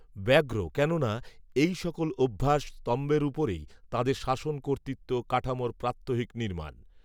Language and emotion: Bengali, neutral